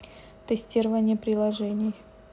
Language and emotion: Russian, neutral